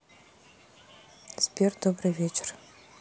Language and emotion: Russian, neutral